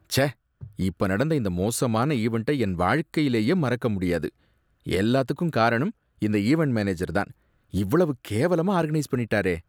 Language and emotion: Tamil, disgusted